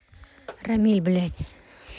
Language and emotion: Russian, angry